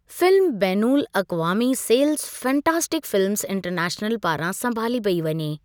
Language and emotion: Sindhi, neutral